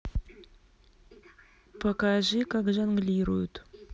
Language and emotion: Russian, neutral